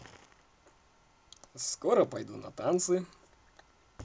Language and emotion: Russian, positive